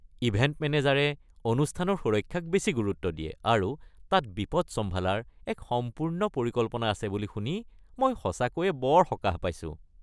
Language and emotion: Assamese, happy